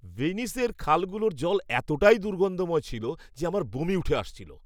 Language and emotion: Bengali, disgusted